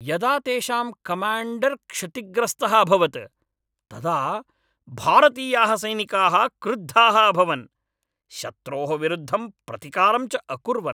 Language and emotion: Sanskrit, angry